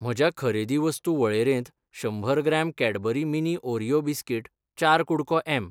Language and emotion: Goan Konkani, neutral